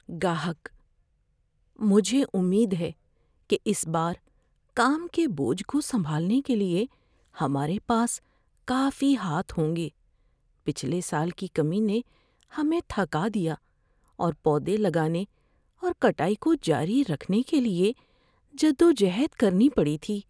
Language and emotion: Urdu, fearful